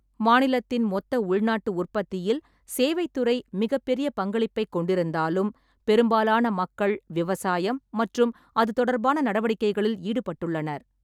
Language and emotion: Tamil, neutral